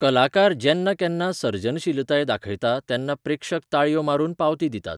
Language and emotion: Goan Konkani, neutral